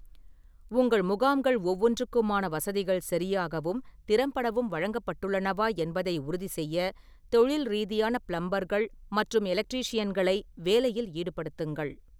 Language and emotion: Tamil, neutral